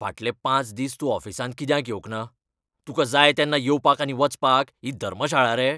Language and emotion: Goan Konkani, angry